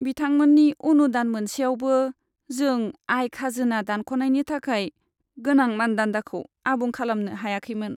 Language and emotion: Bodo, sad